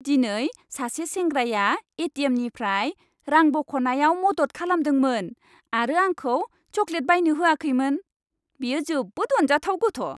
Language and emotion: Bodo, happy